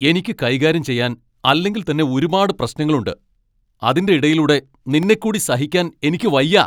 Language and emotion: Malayalam, angry